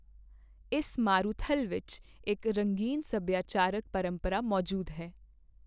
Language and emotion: Punjabi, neutral